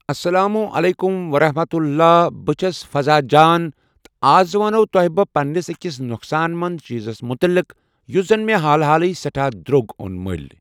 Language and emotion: Kashmiri, neutral